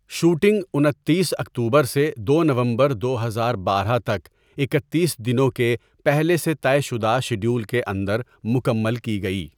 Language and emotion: Urdu, neutral